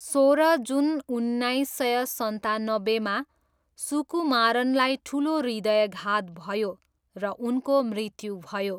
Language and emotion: Nepali, neutral